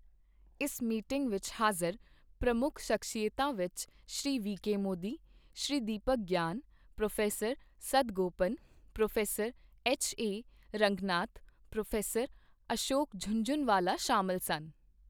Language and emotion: Punjabi, neutral